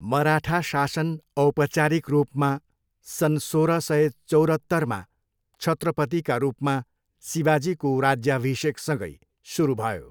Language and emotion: Nepali, neutral